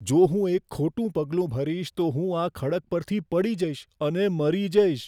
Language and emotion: Gujarati, fearful